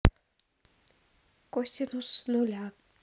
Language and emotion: Russian, neutral